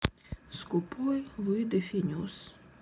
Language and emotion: Russian, sad